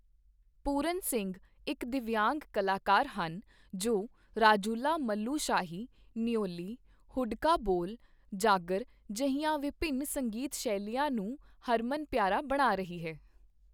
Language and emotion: Punjabi, neutral